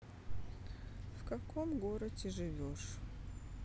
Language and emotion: Russian, neutral